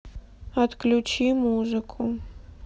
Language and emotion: Russian, sad